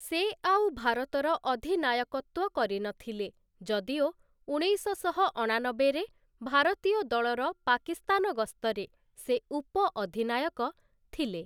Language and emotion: Odia, neutral